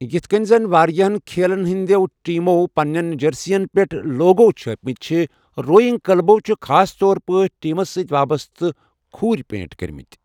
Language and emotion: Kashmiri, neutral